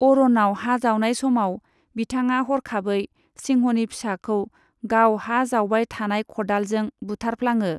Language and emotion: Bodo, neutral